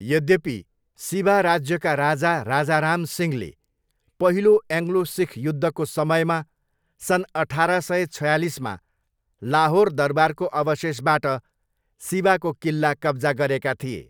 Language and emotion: Nepali, neutral